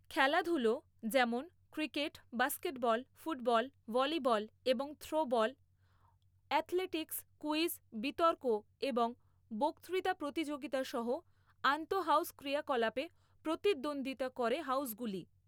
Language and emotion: Bengali, neutral